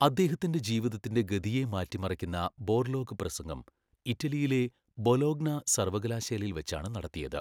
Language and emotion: Malayalam, neutral